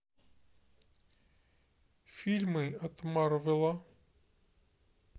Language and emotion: Russian, neutral